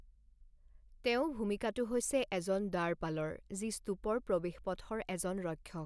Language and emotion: Assamese, neutral